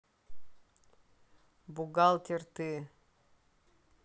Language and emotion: Russian, neutral